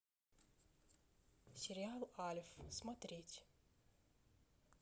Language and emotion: Russian, neutral